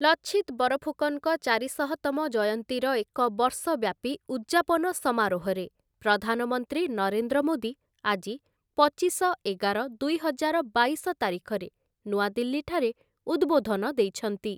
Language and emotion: Odia, neutral